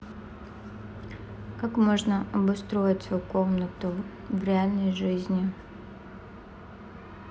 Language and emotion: Russian, neutral